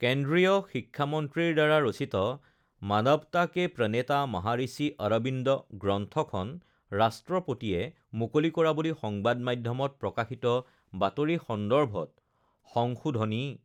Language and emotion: Assamese, neutral